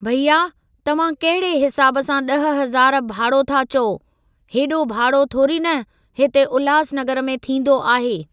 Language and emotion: Sindhi, neutral